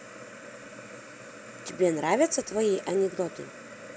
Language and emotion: Russian, positive